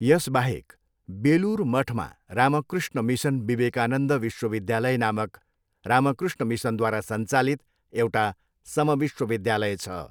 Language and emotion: Nepali, neutral